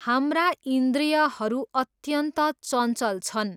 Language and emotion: Nepali, neutral